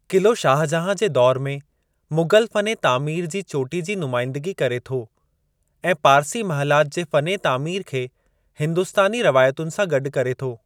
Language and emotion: Sindhi, neutral